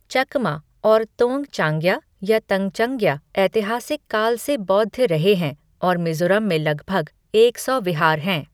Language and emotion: Hindi, neutral